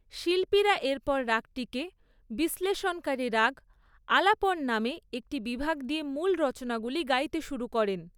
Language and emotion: Bengali, neutral